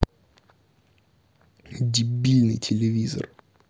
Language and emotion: Russian, angry